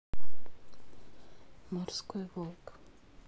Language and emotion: Russian, neutral